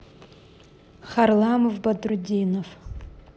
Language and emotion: Russian, neutral